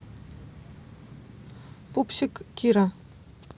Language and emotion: Russian, neutral